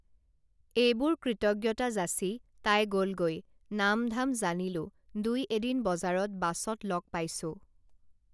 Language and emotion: Assamese, neutral